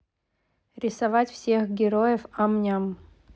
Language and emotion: Russian, neutral